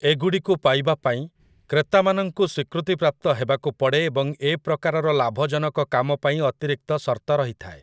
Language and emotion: Odia, neutral